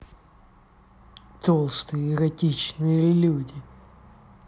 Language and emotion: Russian, angry